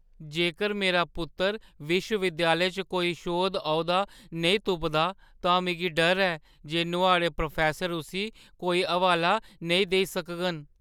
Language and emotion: Dogri, fearful